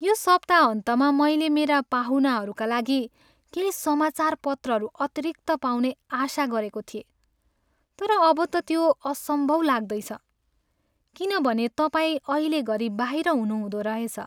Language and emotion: Nepali, sad